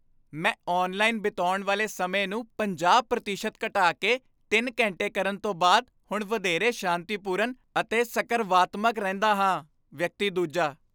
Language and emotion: Punjabi, happy